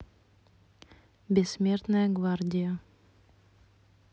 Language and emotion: Russian, neutral